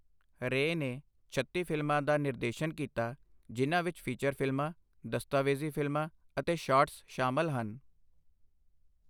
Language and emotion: Punjabi, neutral